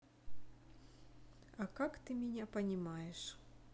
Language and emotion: Russian, neutral